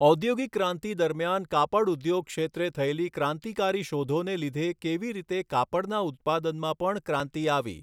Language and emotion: Gujarati, neutral